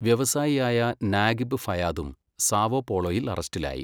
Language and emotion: Malayalam, neutral